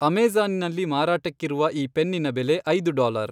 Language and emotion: Kannada, neutral